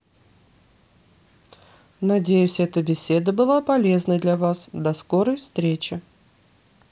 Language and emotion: Russian, neutral